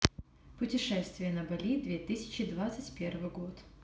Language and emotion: Russian, neutral